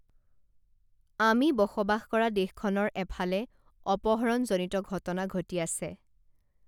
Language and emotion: Assamese, neutral